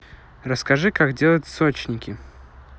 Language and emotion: Russian, neutral